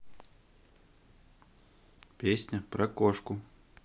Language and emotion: Russian, neutral